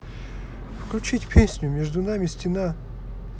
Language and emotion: Russian, neutral